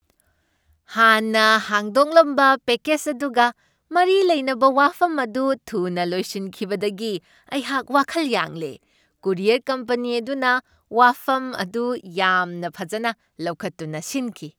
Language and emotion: Manipuri, happy